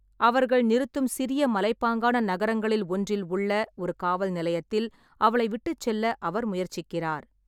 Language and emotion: Tamil, neutral